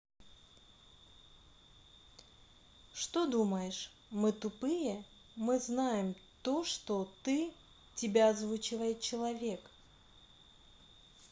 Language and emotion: Russian, neutral